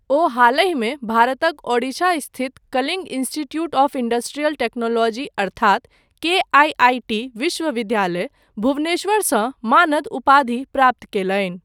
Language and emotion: Maithili, neutral